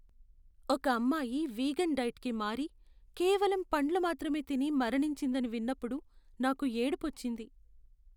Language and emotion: Telugu, sad